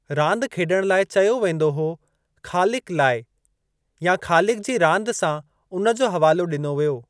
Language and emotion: Sindhi, neutral